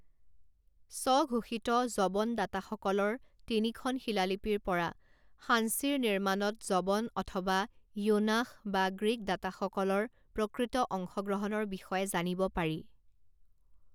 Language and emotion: Assamese, neutral